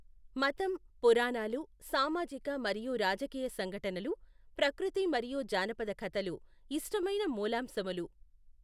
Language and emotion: Telugu, neutral